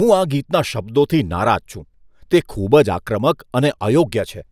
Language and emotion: Gujarati, disgusted